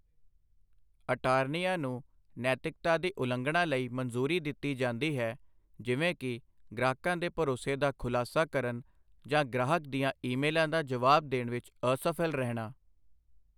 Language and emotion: Punjabi, neutral